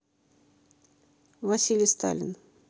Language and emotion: Russian, neutral